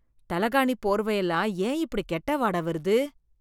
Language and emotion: Tamil, disgusted